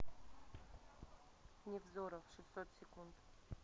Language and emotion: Russian, neutral